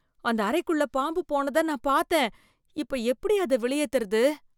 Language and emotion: Tamil, fearful